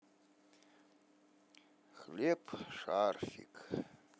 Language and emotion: Russian, neutral